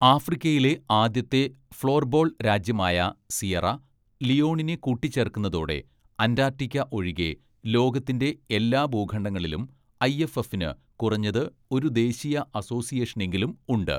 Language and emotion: Malayalam, neutral